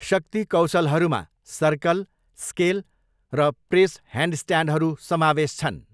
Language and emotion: Nepali, neutral